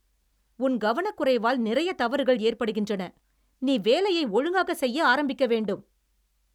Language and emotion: Tamil, angry